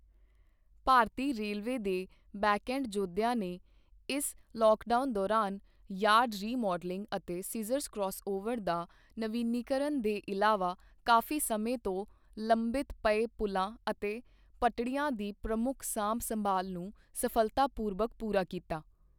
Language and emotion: Punjabi, neutral